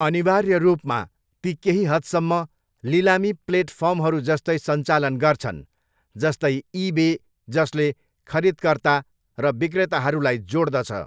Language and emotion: Nepali, neutral